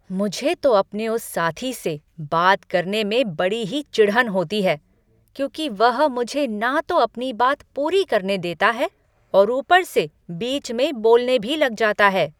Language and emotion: Hindi, angry